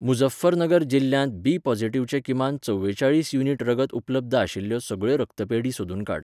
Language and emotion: Goan Konkani, neutral